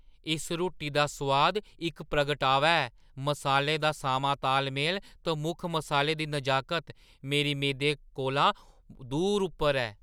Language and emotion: Dogri, surprised